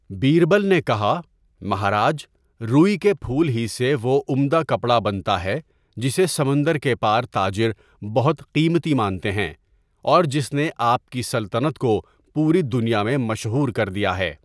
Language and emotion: Urdu, neutral